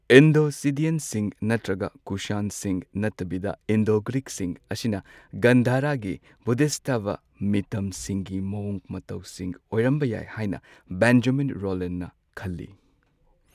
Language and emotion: Manipuri, neutral